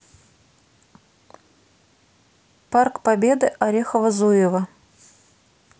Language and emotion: Russian, neutral